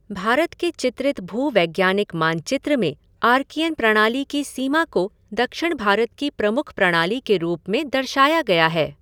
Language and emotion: Hindi, neutral